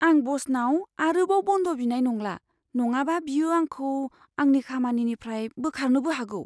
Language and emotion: Bodo, fearful